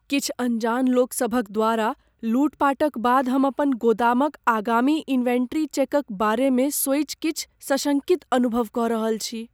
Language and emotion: Maithili, fearful